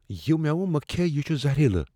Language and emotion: Kashmiri, fearful